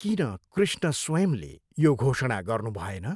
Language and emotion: Nepali, neutral